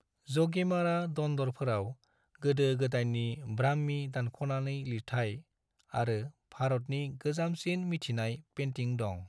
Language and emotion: Bodo, neutral